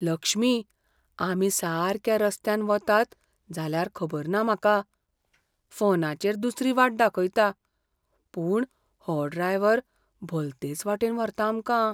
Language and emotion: Goan Konkani, fearful